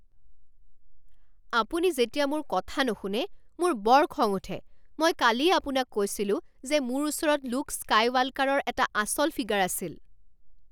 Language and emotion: Assamese, angry